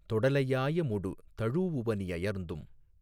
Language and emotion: Tamil, neutral